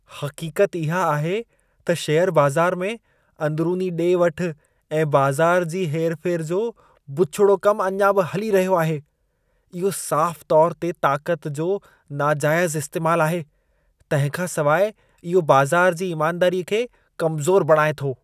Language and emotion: Sindhi, disgusted